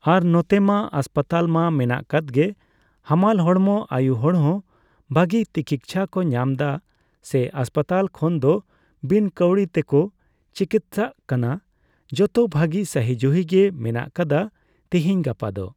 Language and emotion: Santali, neutral